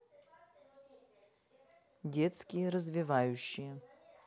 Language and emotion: Russian, neutral